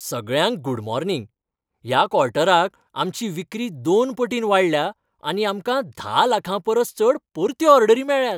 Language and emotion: Goan Konkani, happy